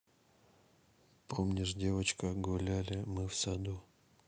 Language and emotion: Russian, neutral